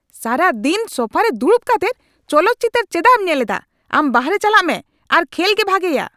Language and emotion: Santali, angry